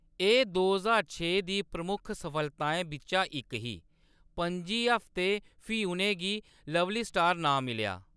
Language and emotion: Dogri, neutral